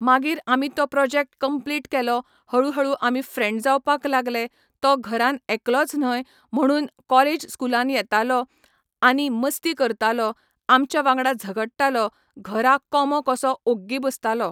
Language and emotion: Goan Konkani, neutral